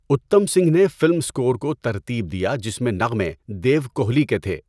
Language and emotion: Urdu, neutral